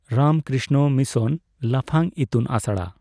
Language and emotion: Santali, neutral